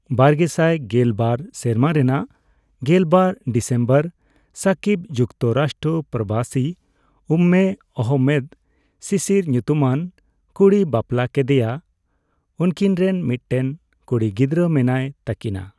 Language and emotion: Santali, neutral